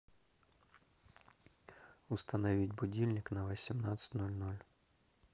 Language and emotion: Russian, neutral